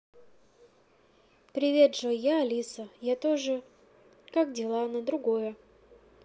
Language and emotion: Russian, neutral